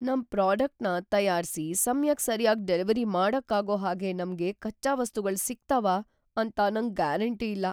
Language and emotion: Kannada, fearful